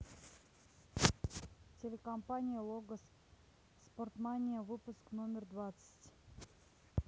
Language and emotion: Russian, neutral